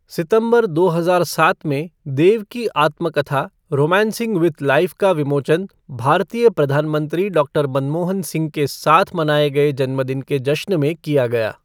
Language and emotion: Hindi, neutral